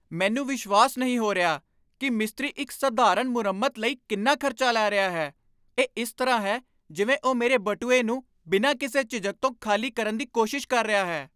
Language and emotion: Punjabi, angry